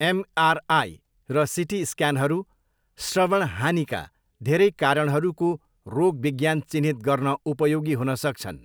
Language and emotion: Nepali, neutral